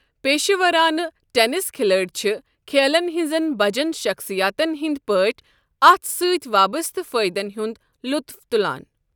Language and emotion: Kashmiri, neutral